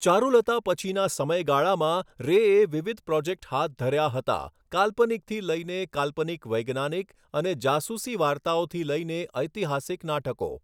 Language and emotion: Gujarati, neutral